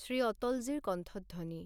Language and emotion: Assamese, neutral